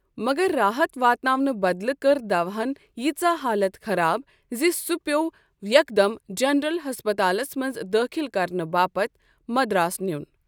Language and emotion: Kashmiri, neutral